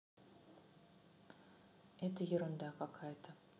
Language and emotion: Russian, neutral